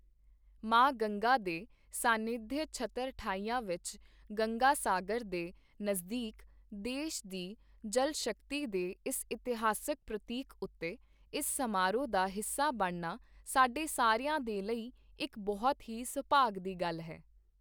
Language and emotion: Punjabi, neutral